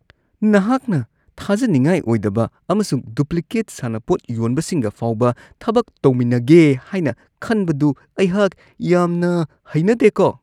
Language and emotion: Manipuri, disgusted